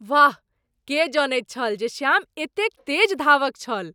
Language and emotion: Maithili, surprised